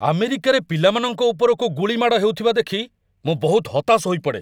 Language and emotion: Odia, angry